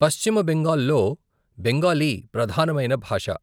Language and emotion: Telugu, neutral